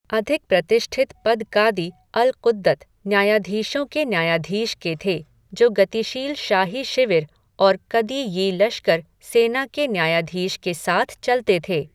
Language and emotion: Hindi, neutral